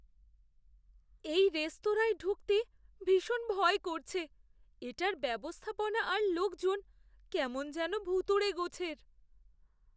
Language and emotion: Bengali, fearful